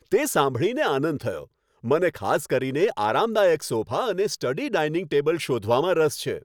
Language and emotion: Gujarati, happy